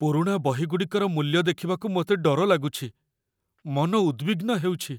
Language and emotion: Odia, fearful